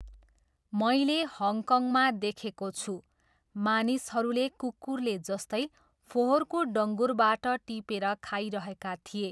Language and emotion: Nepali, neutral